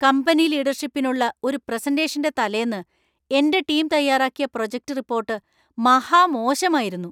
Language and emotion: Malayalam, angry